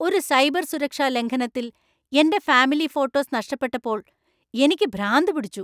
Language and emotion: Malayalam, angry